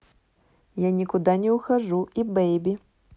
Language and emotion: Russian, neutral